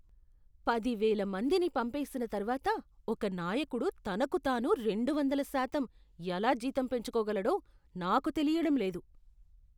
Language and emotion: Telugu, disgusted